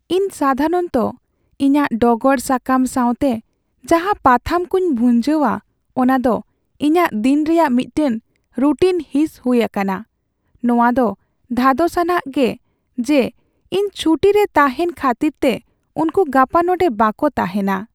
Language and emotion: Santali, sad